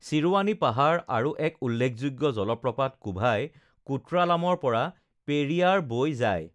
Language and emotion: Assamese, neutral